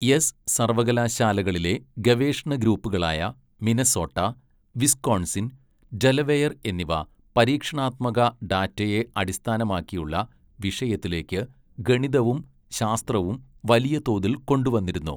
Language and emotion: Malayalam, neutral